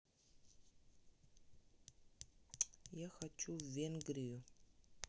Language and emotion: Russian, neutral